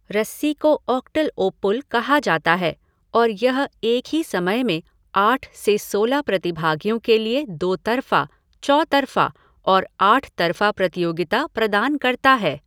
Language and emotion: Hindi, neutral